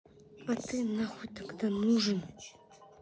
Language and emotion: Russian, angry